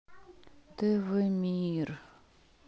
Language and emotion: Russian, sad